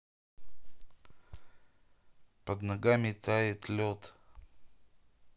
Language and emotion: Russian, neutral